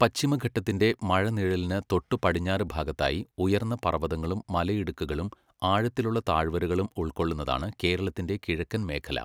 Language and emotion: Malayalam, neutral